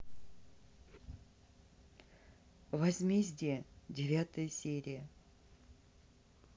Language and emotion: Russian, neutral